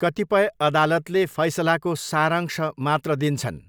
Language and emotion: Nepali, neutral